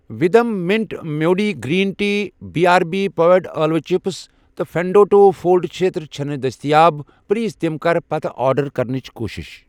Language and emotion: Kashmiri, neutral